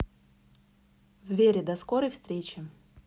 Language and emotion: Russian, neutral